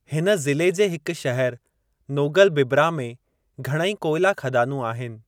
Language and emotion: Sindhi, neutral